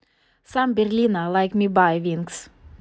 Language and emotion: Russian, neutral